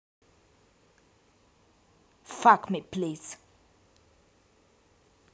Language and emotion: Russian, angry